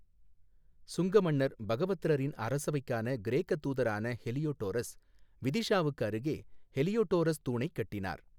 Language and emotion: Tamil, neutral